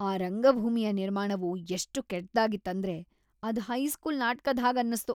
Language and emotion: Kannada, disgusted